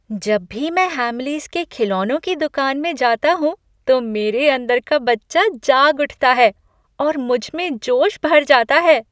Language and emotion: Hindi, happy